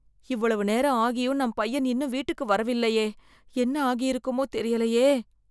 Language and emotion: Tamil, fearful